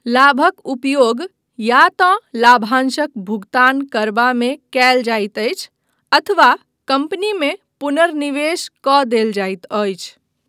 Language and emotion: Maithili, neutral